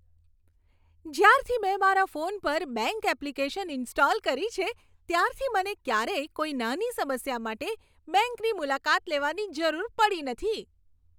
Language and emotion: Gujarati, happy